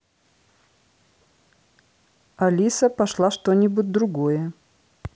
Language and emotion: Russian, neutral